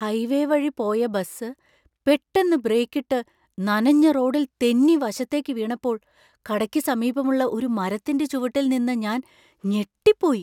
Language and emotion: Malayalam, surprised